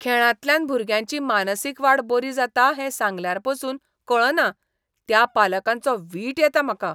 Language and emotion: Goan Konkani, disgusted